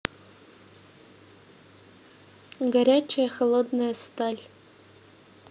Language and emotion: Russian, neutral